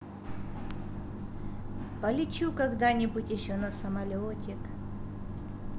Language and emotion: Russian, positive